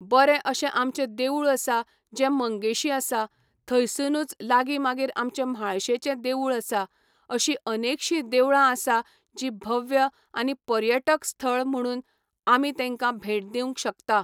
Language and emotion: Goan Konkani, neutral